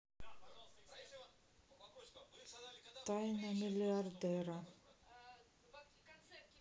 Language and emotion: Russian, sad